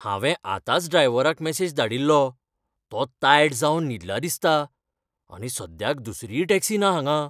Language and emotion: Goan Konkani, fearful